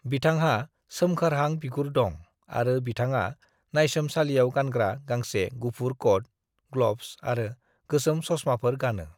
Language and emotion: Bodo, neutral